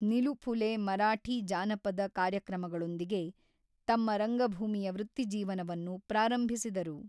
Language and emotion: Kannada, neutral